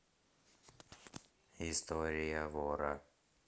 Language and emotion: Russian, neutral